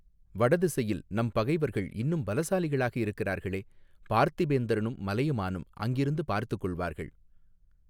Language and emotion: Tamil, neutral